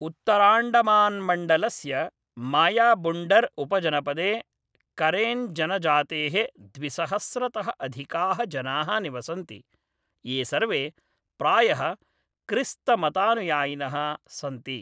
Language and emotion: Sanskrit, neutral